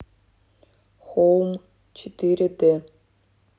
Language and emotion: Russian, neutral